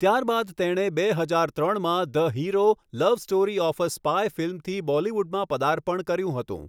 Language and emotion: Gujarati, neutral